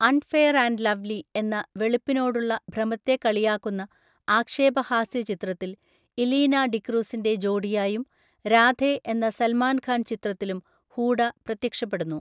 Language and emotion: Malayalam, neutral